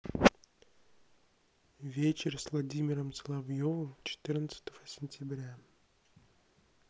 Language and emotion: Russian, neutral